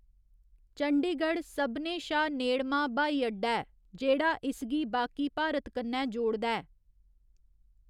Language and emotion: Dogri, neutral